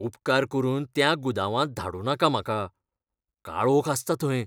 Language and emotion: Goan Konkani, fearful